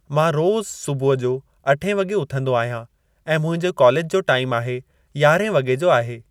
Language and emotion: Sindhi, neutral